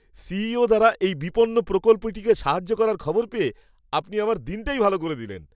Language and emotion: Bengali, happy